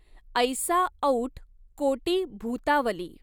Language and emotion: Marathi, neutral